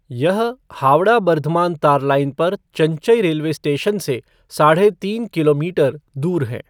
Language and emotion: Hindi, neutral